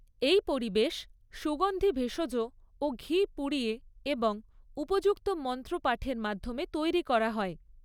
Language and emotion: Bengali, neutral